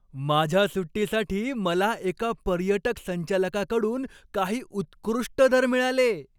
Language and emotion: Marathi, happy